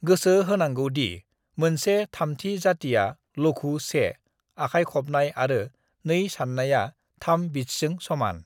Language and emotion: Bodo, neutral